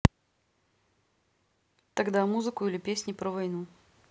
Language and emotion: Russian, neutral